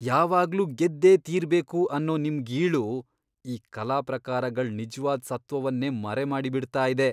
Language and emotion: Kannada, disgusted